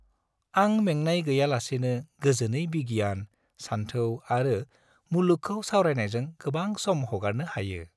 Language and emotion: Bodo, happy